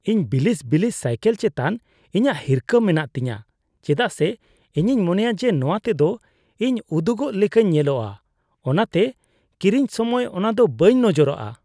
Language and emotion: Santali, disgusted